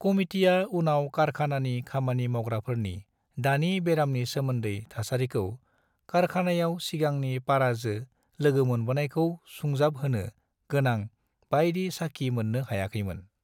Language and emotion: Bodo, neutral